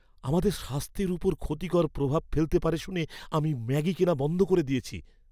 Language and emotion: Bengali, fearful